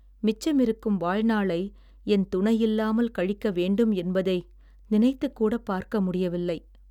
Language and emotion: Tamil, sad